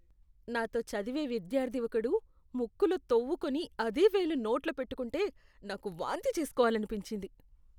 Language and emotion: Telugu, disgusted